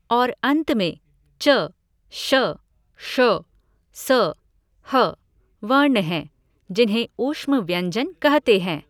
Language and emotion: Hindi, neutral